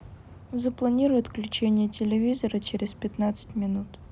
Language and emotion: Russian, neutral